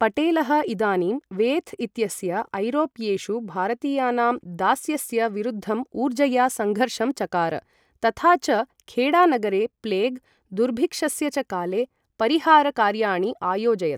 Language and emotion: Sanskrit, neutral